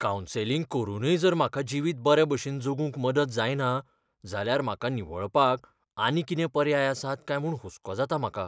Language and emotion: Goan Konkani, fearful